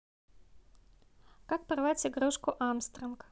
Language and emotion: Russian, neutral